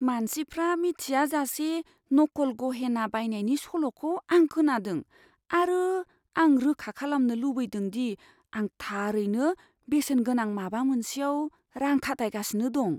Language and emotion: Bodo, fearful